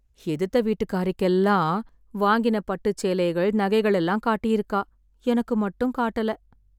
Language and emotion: Tamil, sad